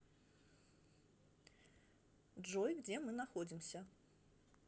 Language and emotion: Russian, neutral